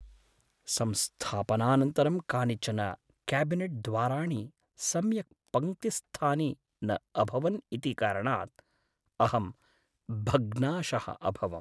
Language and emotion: Sanskrit, sad